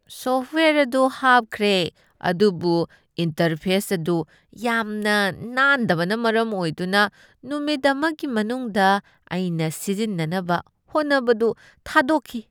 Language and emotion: Manipuri, disgusted